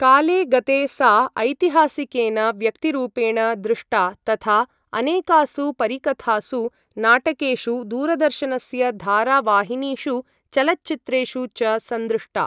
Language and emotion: Sanskrit, neutral